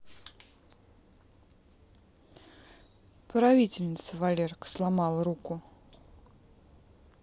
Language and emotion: Russian, neutral